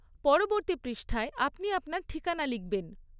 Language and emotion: Bengali, neutral